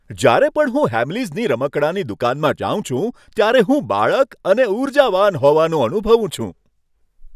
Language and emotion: Gujarati, happy